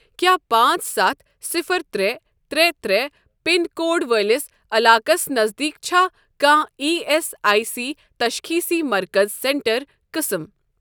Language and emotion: Kashmiri, neutral